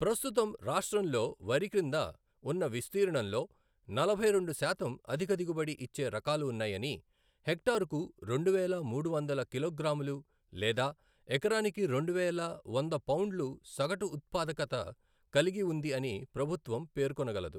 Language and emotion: Telugu, neutral